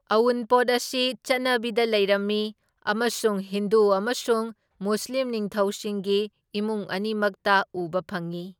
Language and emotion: Manipuri, neutral